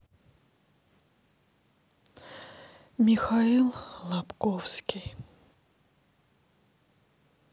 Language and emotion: Russian, sad